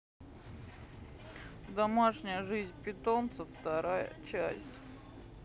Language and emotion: Russian, sad